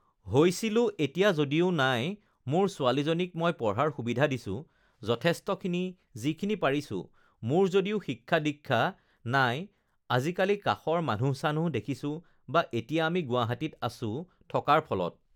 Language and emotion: Assamese, neutral